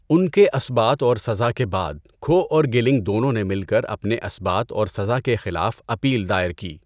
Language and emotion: Urdu, neutral